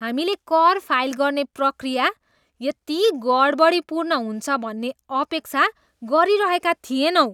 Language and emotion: Nepali, disgusted